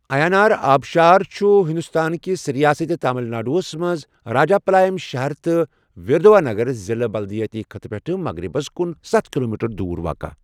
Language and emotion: Kashmiri, neutral